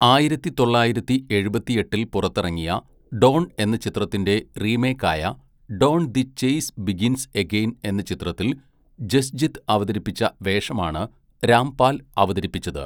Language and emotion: Malayalam, neutral